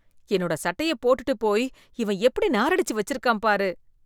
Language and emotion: Tamil, disgusted